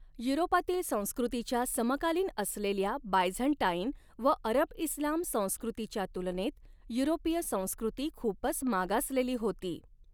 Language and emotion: Marathi, neutral